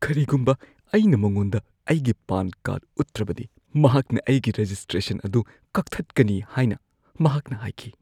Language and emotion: Manipuri, fearful